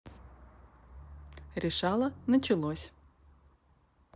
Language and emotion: Russian, neutral